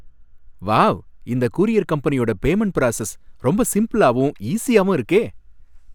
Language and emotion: Tamil, happy